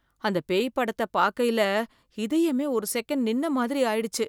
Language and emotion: Tamil, fearful